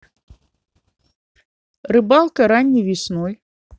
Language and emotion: Russian, neutral